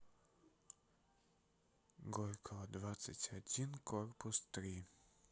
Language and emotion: Russian, neutral